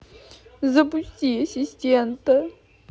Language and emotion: Russian, sad